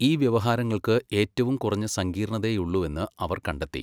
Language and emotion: Malayalam, neutral